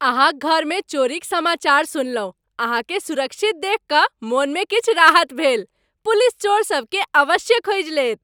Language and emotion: Maithili, happy